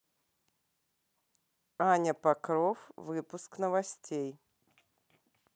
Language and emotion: Russian, neutral